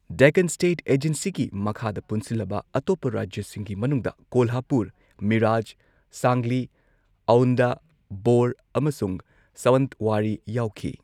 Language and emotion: Manipuri, neutral